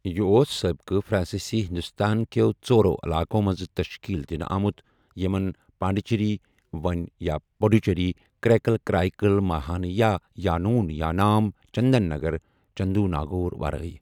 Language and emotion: Kashmiri, neutral